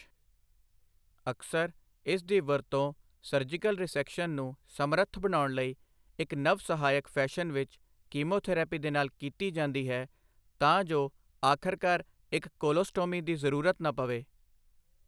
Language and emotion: Punjabi, neutral